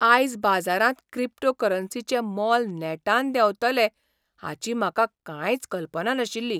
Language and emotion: Goan Konkani, surprised